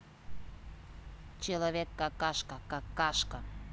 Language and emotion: Russian, neutral